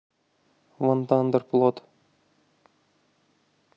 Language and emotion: Russian, neutral